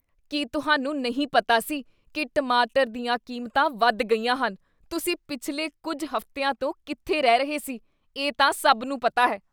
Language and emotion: Punjabi, disgusted